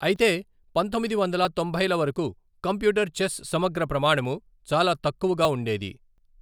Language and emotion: Telugu, neutral